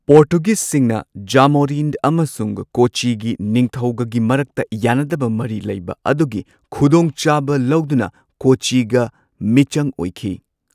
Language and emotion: Manipuri, neutral